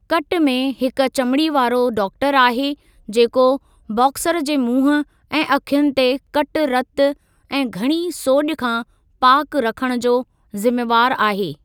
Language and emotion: Sindhi, neutral